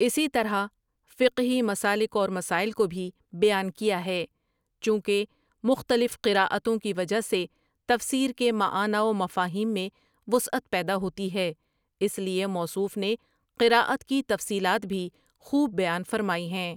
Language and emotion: Urdu, neutral